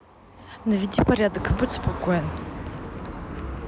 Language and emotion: Russian, neutral